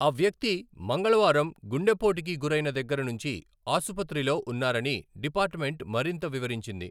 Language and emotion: Telugu, neutral